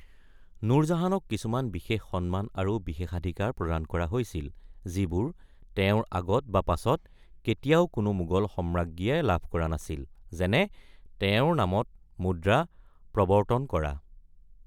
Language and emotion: Assamese, neutral